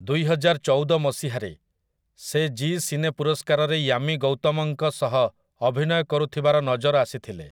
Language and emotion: Odia, neutral